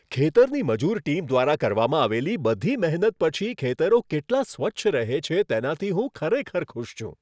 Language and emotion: Gujarati, happy